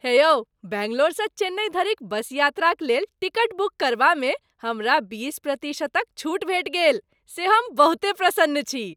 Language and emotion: Maithili, happy